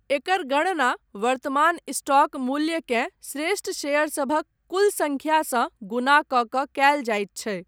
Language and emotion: Maithili, neutral